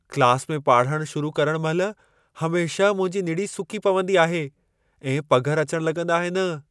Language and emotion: Sindhi, fearful